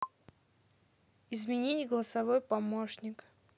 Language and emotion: Russian, neutral